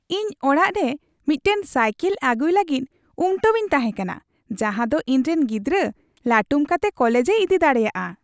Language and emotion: Santali, happy